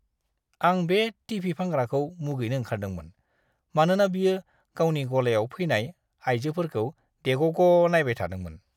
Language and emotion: Bodo, disgusted